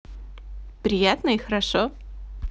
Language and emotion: Russian, positive